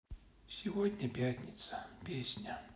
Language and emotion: Russian, sad